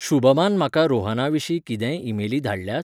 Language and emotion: Goan Konkani, neutral